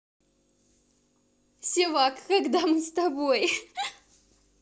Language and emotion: Russian, positive